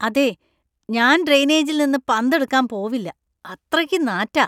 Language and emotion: Malayalam, disgusted